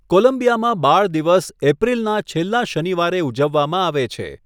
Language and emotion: Gujarati, neutral